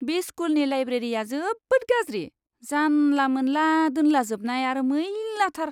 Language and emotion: Bodo, disgusted